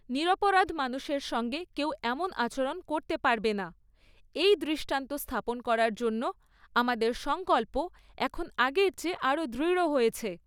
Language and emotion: Bengali, neutral